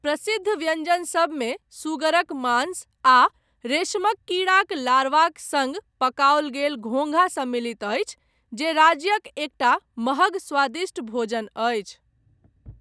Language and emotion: Maithili, neutral